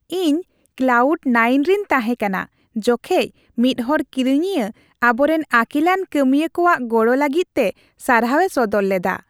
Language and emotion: Santali, happy